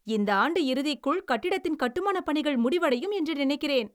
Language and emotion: Tamil, happy